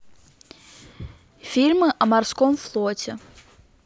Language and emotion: Russian, neutral